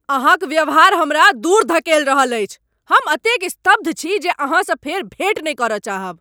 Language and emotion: Maithili, angry